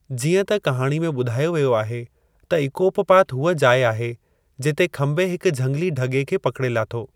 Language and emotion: Sindhi, neutral